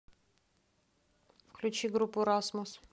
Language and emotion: Russian, neutral